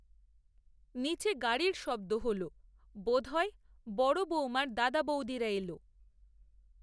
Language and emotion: Bengali, neutral